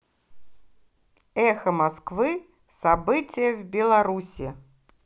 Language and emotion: Russian, positive